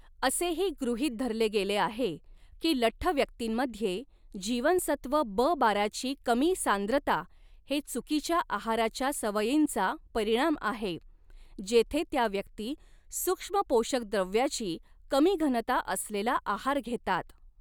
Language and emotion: Marathi, neutral